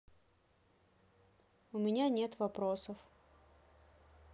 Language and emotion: Russian, sad